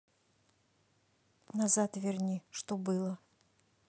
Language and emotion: Russian, neutral